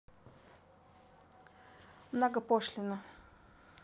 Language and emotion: Russian, neutral